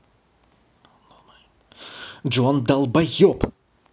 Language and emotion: Russian, angry